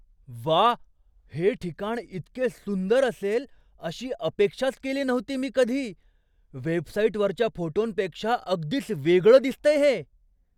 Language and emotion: Marathi, surprised